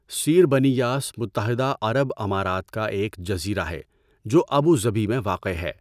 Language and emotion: Urdu, neutral